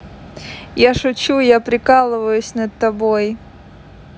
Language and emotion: Russian, positive